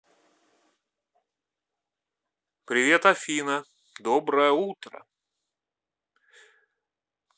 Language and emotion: Russian, positive